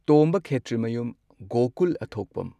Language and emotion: Manipuri, neutral